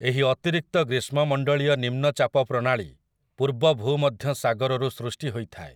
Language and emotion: Odia, neutral